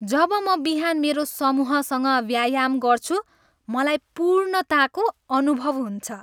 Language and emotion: Nepali, happy